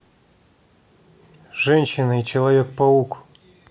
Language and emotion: Russian, neutral